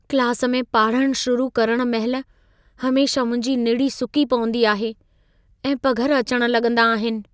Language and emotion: Sindhi, fearful